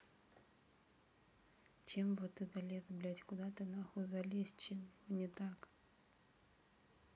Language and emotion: Russian, neutral